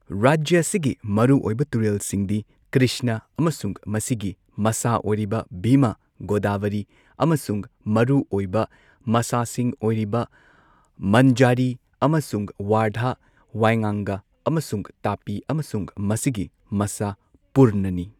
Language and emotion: Manipuri, neutral